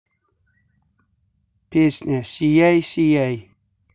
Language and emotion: Russian, neutral